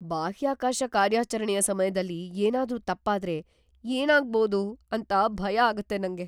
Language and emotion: Kannada, fearful